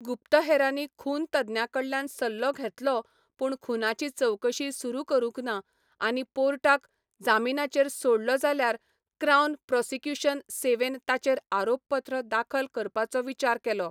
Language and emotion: Goan Konkani, neutral